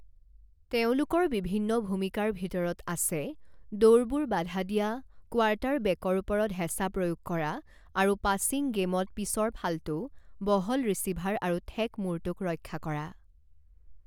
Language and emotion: Assamese, neutral